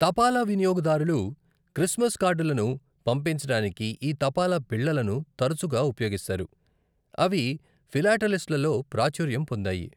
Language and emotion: Telugu, neutral